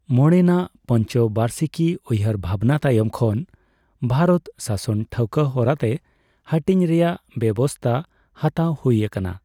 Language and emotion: Santali, neutral